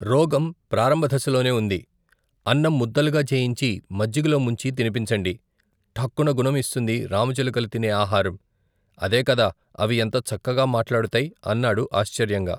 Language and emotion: Telugu, neutral